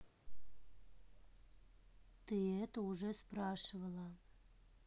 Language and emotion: Russian, neutral